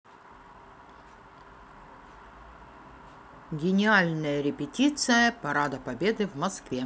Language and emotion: Russian, neutral